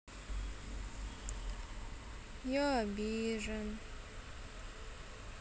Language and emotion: Russian, sad